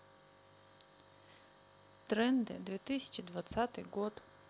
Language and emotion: Russian, neutral